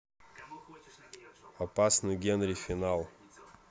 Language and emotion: Russian, neutral